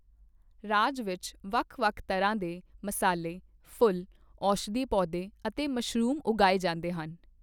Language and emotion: Punjabi, neutral